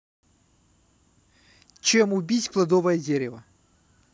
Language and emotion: Russian, neutral